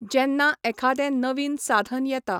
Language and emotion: Goan Konkani, neutral